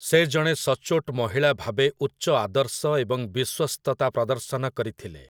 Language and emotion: Odia, neutral